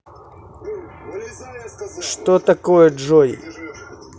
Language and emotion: Russian, neutral